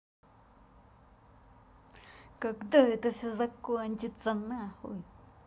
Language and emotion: Russian, angry